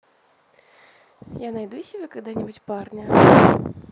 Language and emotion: Russian, neutral